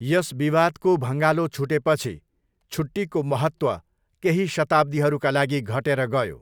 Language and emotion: Nepali, neutral